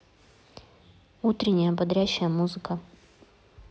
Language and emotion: Russian, neutral